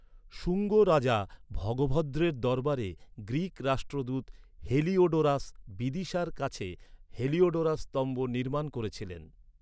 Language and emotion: Bengali, neutral